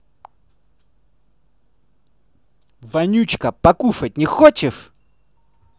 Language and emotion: Russian, angry